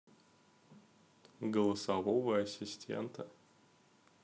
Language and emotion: Russian, neutral